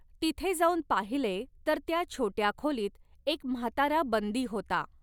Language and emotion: Marathi, neutral